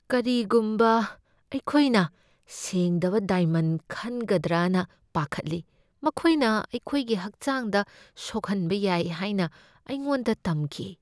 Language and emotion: Manipuri, fearful